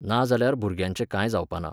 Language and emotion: Goan Konkani, neutral